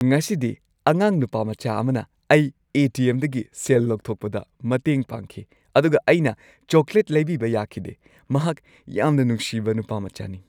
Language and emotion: Manipuri, happy